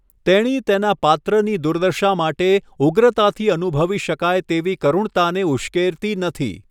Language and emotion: Gujarati, neutral